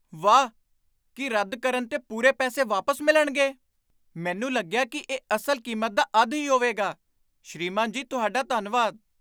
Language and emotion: Punjabi, surprised